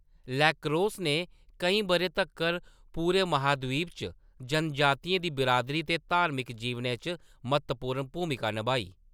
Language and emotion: Dogri, neutral